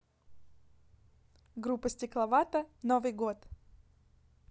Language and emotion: Russian, neutral